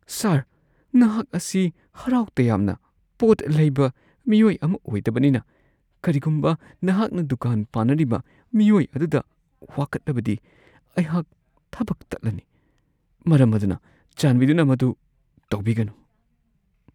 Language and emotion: Manipuri, fearful